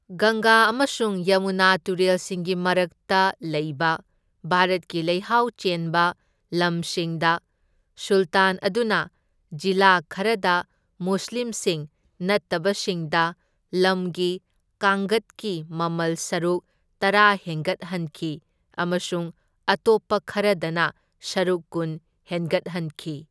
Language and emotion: Manipuri, neutral